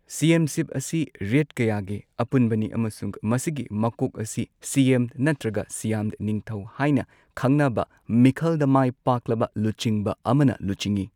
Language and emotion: Manipuri, neutral